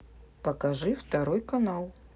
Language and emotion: Russian, neutral